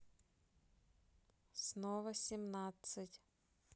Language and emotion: Russian, neutral